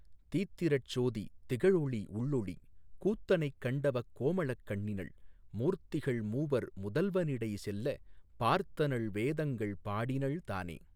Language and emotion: Tamil, neutral